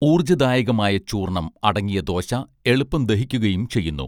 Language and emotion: Malayalam, neutral